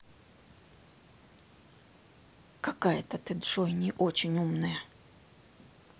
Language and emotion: Russian, angry